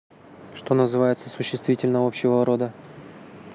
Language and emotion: Russian, neutral